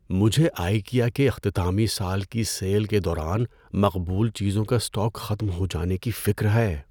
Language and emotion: Urdu, fearful